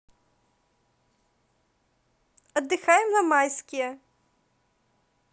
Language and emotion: Russian, positive